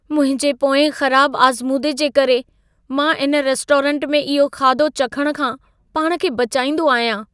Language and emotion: Sindhi, fearful